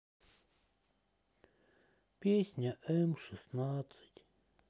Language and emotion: Russian, sad